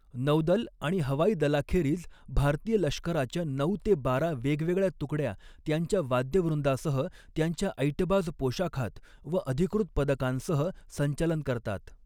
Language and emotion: Marathi, neutral